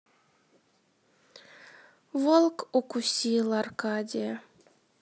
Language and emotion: Russian, sad